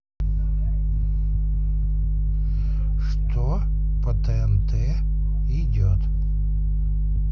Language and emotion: Russian, neutral